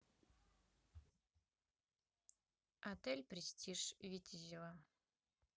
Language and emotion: Russian, neutral